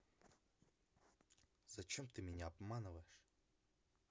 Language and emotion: Russian, angry